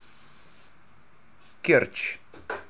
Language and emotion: Russian, neutral